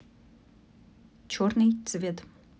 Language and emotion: Russian, neutral